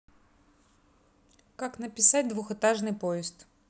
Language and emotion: Russian, neutral